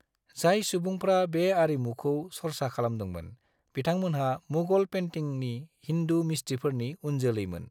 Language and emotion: Bodo, neutral